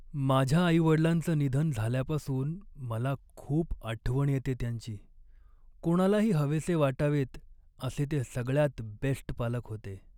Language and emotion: Marathi, sad